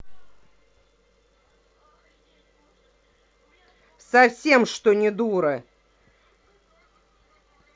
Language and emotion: Russian, angry